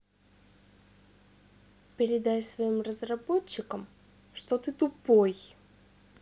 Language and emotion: Russian, angry